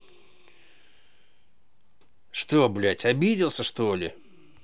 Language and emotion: Russian, angry